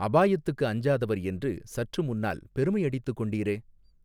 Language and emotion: Tamil, neutral